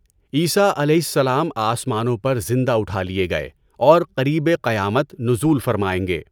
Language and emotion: Urdu, neutral